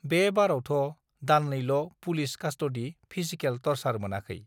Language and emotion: Bodo, neutral